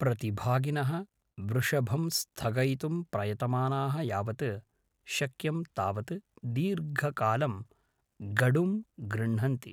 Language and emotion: Sanskrit, neutral